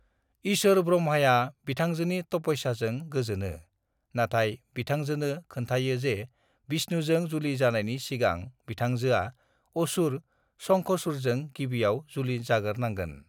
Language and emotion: Bodo, neutral